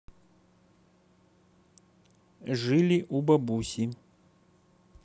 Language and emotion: Russian, neutral